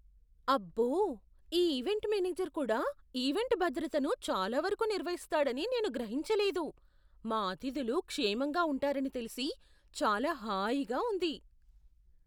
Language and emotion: Telugu, surprised